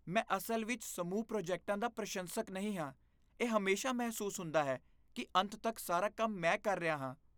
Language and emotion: Punjabi, disgusted